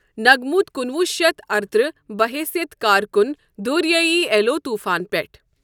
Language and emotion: Kashmiri, neutral